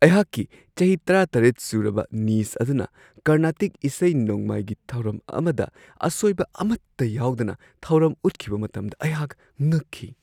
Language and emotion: Manipuri, surprised